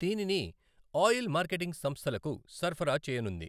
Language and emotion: Telugu, neutral